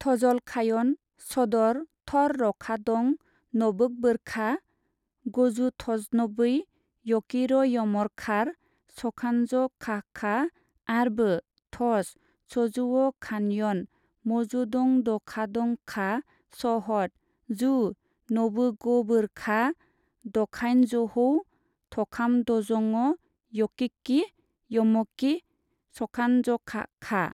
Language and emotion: Bodo, neutral